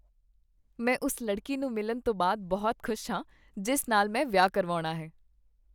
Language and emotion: Punjabi, happy